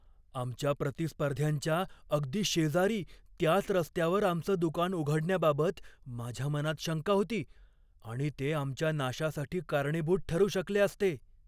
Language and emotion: Marathi, fearful